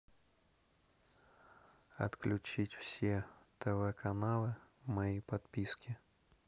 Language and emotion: Russian, neutral